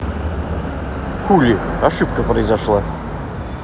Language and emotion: Russian, angry